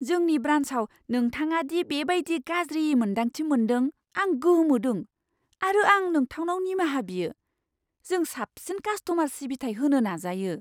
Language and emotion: Bodo, surprised